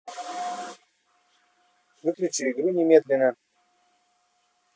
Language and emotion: Russian, angry